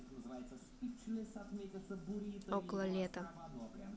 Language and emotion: Russian, neutral